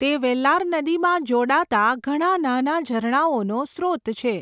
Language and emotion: Gujarati, neutral